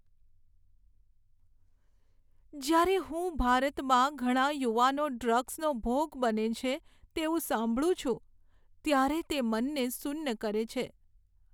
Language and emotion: Gujarati, sad